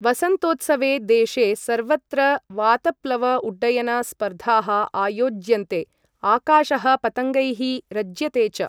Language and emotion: Sanskrit, neutral